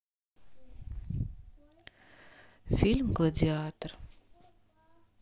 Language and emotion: Russian, sad